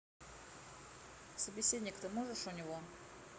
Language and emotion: Russian, neutral